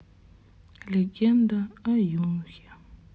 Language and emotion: Russian, sad